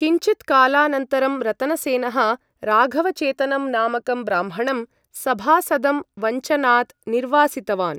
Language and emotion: Sanskrit, neutral